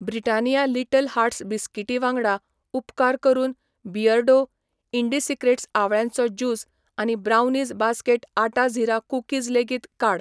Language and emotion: Goan Konkani, neutral